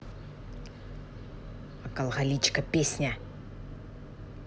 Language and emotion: Russian, angry